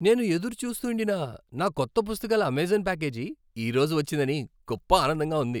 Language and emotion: Telugu, happy